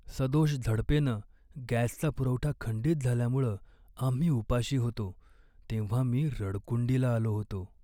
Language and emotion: Marathi, sad